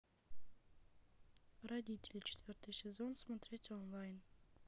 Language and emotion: Russian, neutral